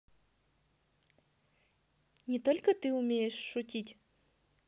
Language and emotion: Russian, positive